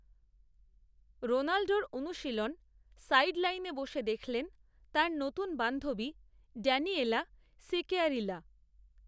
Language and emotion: Bengali, neutral